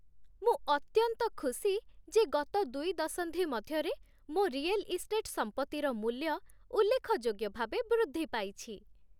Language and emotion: Odia, happy